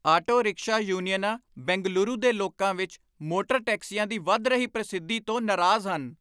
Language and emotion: Punjabi, angry